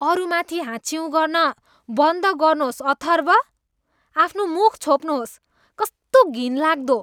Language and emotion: Nepali, disgusted